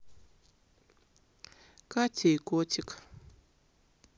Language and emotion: Russian, sad